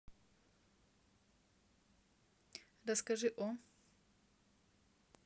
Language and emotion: Russian, neutral